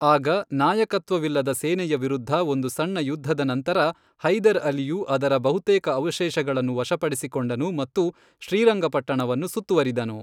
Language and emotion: Kannada, neutral